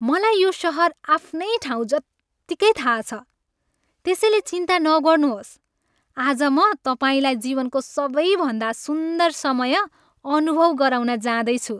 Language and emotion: Nepali, happy